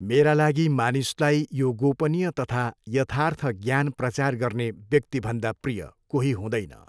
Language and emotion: Nepali, neutral